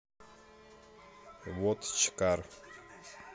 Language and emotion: Russian, neutral